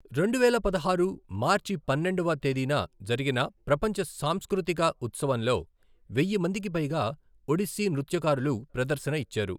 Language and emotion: Telugu, neutral